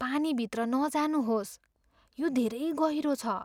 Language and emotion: Nepali, fearful